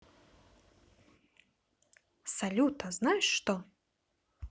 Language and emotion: Russian, positive